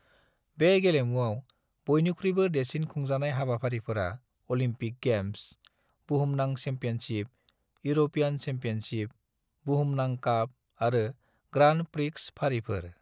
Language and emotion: Bodo, neutral